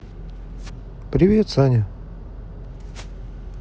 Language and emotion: Russian, neutral